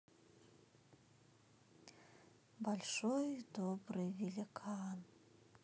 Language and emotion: Russian, neutral